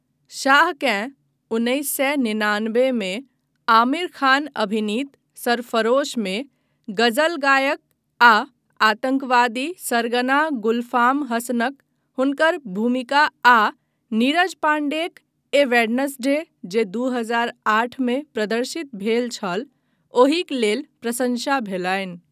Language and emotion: Maithili, neutral